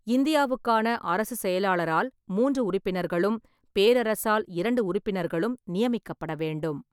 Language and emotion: Tamil, neutral